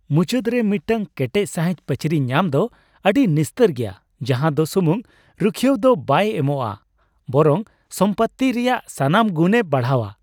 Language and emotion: Santali, happy